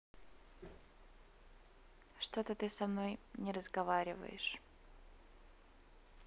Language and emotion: Russian, neutral